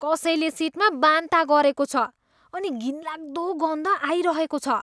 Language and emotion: Nepali, disgusted